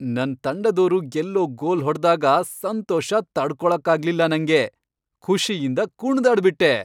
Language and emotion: Kannada, happy